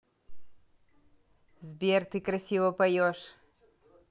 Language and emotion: Russian, positive